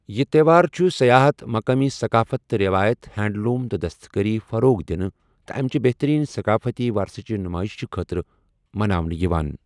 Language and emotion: Kashmiri, neutral